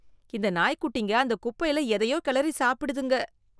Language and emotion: Tamil, disgusted